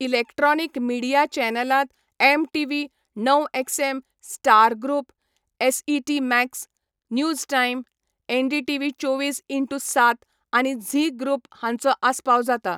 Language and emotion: Goan Konkani, neutral